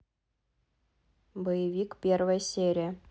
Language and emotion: Russian, neutral